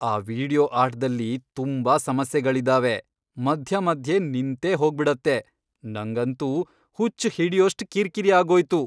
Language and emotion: Kannada, angry